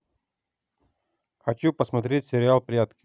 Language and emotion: Russian, neutral